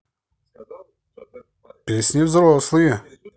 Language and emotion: Russian, positive